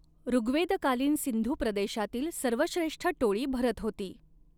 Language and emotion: Marathi, neutral